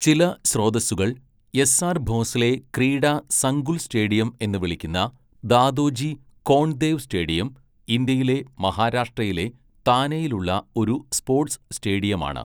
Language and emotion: Malayalam, neutral